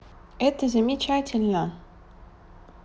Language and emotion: Russian, positive